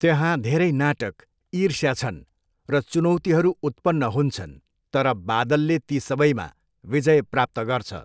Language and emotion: Nepali, neutral